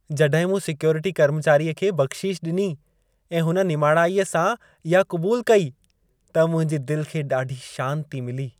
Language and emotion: Sindhi, happy